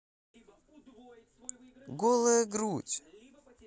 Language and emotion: Russian, positive